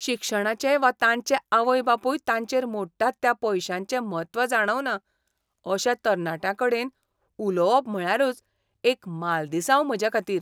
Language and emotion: Goan Konkani, disgusted